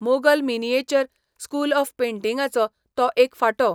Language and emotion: Goan Konkani, neutral